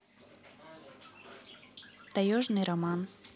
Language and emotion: Russian, neutral